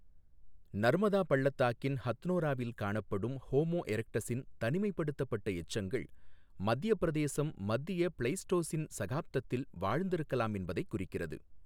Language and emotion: Tamil, neutral